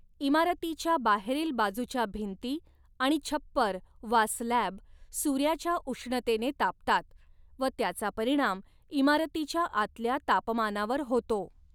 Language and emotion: Marathi, neutral